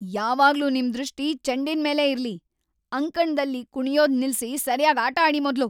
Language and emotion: Kannada, angry